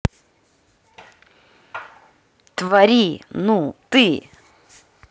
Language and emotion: Russian, angry